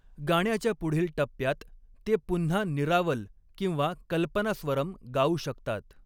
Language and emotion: Marathi, neutral